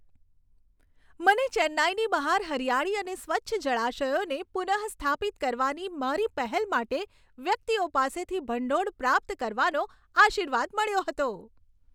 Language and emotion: Gujarati, happy